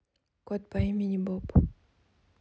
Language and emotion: Russian, neutral